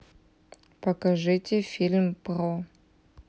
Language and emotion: Russian, neutral